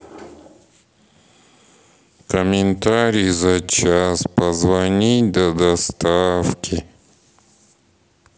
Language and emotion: Russian, sad